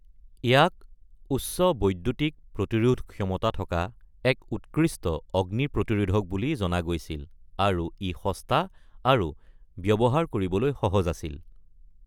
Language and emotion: Assamese, neutral